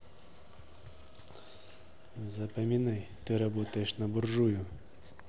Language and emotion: Russian, neutral